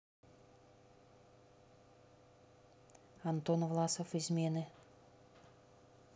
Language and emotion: Russian, neutral